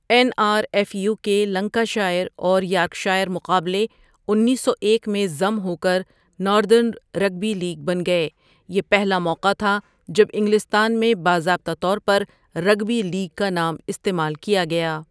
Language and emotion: Urdu, neutral